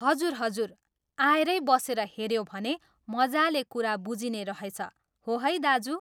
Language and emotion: Nepali, neutral